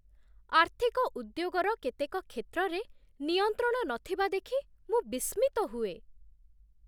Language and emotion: Odia, surprised